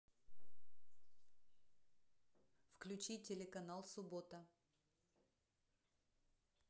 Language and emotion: Russian, neutral